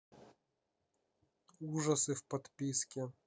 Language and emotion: Russian, neutral